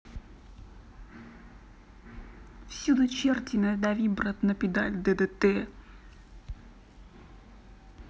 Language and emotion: Russian, neutral